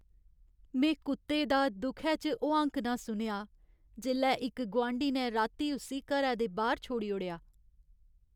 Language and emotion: Dogri, sad